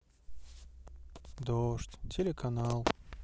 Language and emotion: Russian, neutral